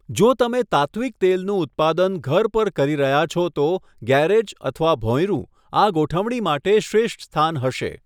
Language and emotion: Gujarati, neutral